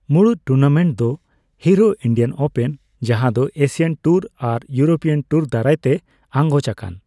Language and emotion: Santali, neutral